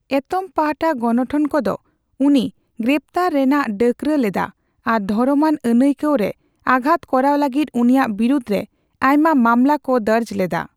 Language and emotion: Santali, neutral